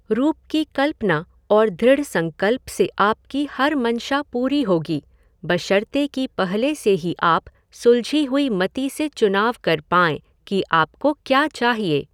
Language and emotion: Hindi, neutral